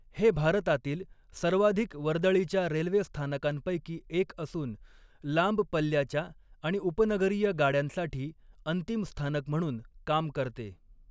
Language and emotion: Marathi, neutral